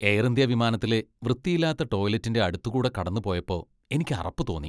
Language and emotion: Malayalam, disgusted